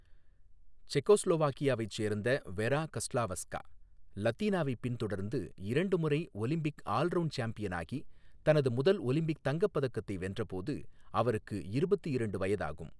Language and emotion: Tamil, neutral